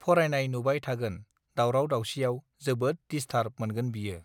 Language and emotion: Bodo, neutral